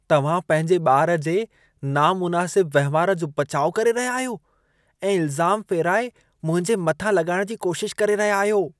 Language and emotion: Sindhi, disgusted